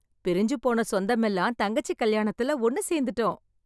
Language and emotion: Tamil, happy